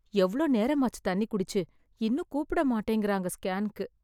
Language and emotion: Tamil, sad